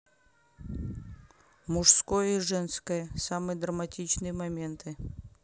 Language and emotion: Russian, neutral